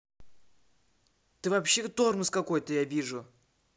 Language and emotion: Russian, angry